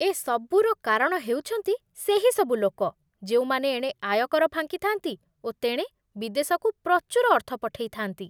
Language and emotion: Odia, disgusted